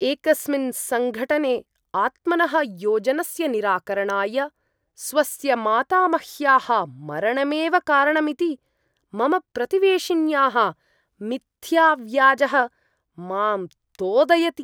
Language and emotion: Sanskrit, disgusted